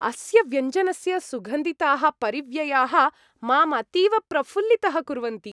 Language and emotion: Sanskrit, happy